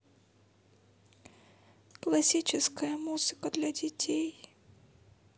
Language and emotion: Russian, sad